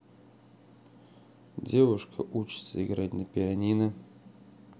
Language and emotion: Russian, neutral